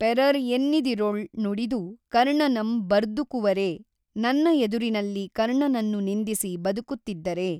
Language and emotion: Kannada, neutral